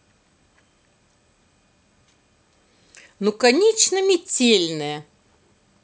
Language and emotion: Russian, positive